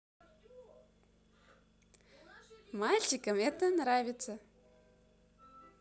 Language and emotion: Russian, positive